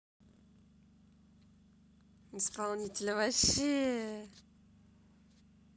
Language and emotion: Russian, positive